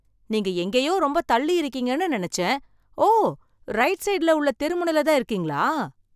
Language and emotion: Tamil, surprised